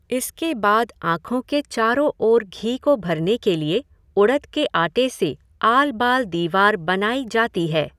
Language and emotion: Hindi, neutral